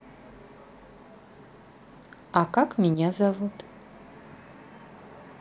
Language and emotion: Russian, neutral